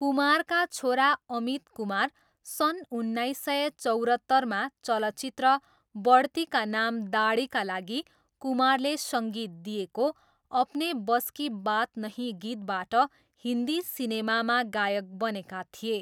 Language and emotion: Nepali, neutral